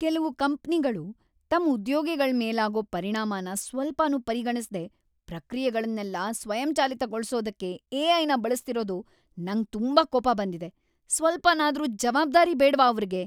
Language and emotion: Kannada, angry